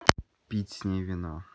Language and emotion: Russian, neutral